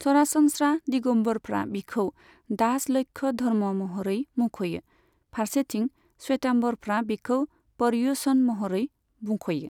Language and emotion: Bodo, neutral